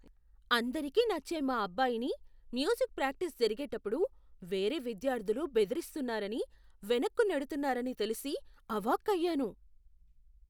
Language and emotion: Telugu, surprised